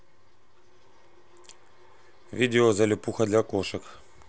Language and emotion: Russian, neutral